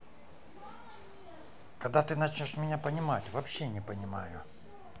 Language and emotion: Russian, angry